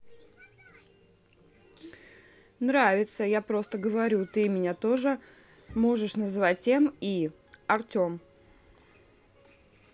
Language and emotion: Russian, neutral